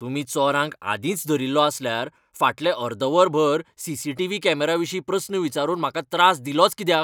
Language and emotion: Goan Konkani, angry